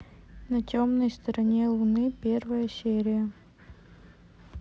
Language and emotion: Russian, neutral